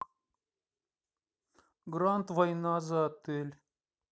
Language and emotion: Russian, neutral